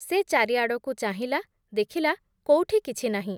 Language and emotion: Odia, neutral